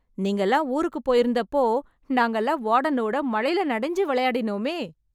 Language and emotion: Tamil, happy